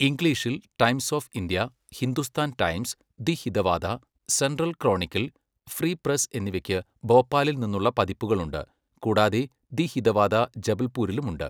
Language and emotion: Malayalam, neutral